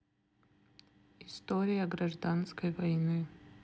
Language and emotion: Russian, neutral